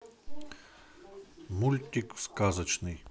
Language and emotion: Russian, neutral